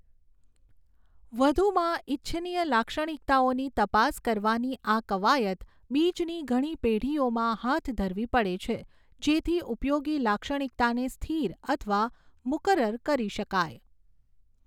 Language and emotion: Gujarati, neutral